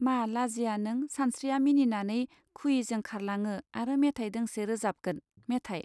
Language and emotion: Bodo, neutral